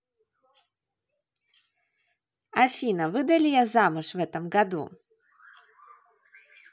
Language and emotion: Russian, positive